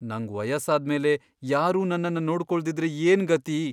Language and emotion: Kannada, fearful